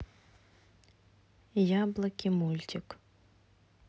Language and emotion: Russian, neutral